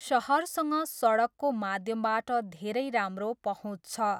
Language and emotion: Nepali, neutral